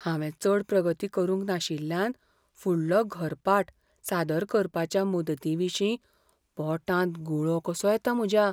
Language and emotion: Goan Konkani, fearful